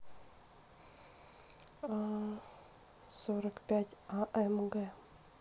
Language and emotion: Russian, neutral